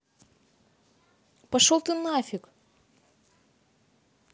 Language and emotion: Russian, angry